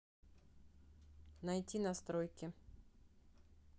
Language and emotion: Russian, neutral